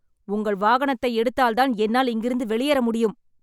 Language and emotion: Tamil, angry